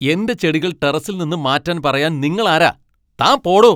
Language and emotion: Malayalam, angry